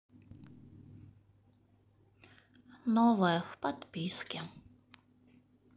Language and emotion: Russian, sad